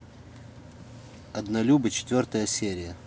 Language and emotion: Russian, neutral